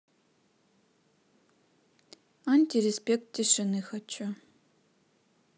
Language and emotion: Russian, neutral